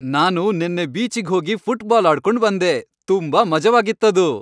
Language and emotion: Kannada, happy